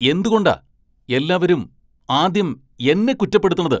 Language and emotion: Malayalam, angry